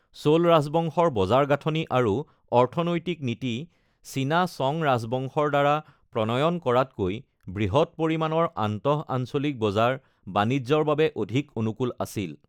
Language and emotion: Assamese, neutral